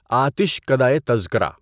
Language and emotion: Urdu, neutral